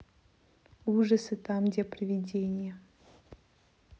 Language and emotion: Russian, neutral